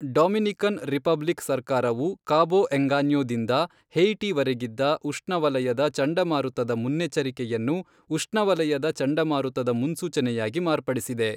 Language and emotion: Kannada, neutral